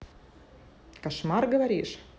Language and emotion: Russian, neutral